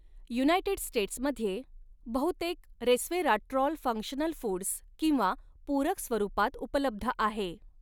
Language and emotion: Marathi, neutral